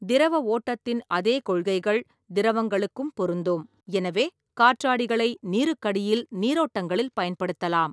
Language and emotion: Tamil, neutral